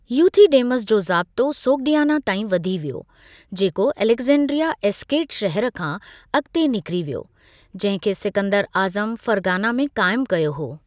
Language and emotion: Sindhi, neutral